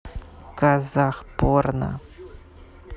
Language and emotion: Russian, neutral